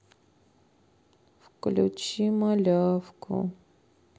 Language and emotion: Russian, sad